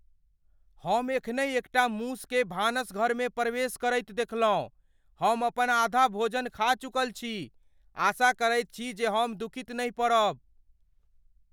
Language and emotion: Maithili, fearful